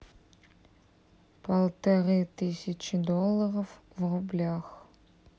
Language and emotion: Russian, neutral